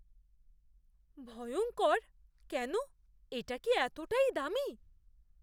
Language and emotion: Bengali, fearful